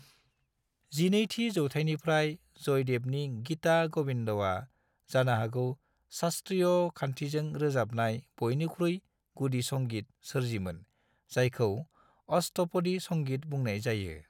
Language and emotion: Bodo, neutral